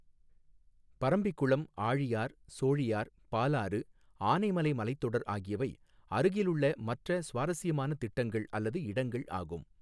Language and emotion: Tamil, neutral